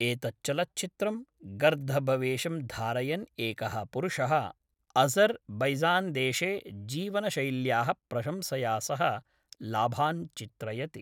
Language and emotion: Sanskrit, neutral